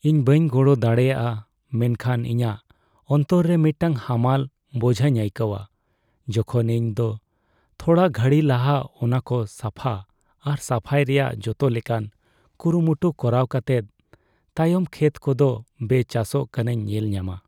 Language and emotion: Santali, sad